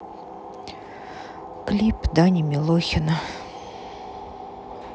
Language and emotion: Russian, sad